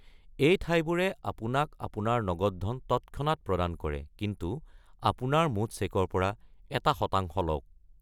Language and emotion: Assamese, neutral